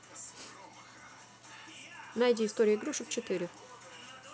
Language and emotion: Russian, neutral